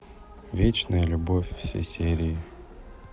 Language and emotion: Russian, neutral